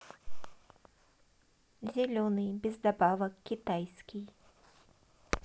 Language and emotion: Russian, neutral